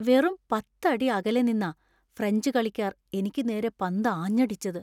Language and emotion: Malayalam, fearful